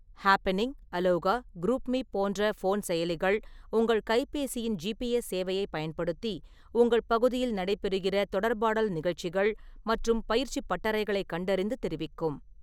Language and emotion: Tamil, neutral